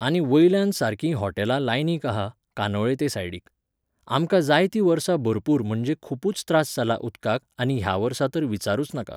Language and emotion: Goan Konkani, neutral